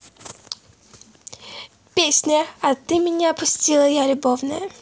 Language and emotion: Russian, positive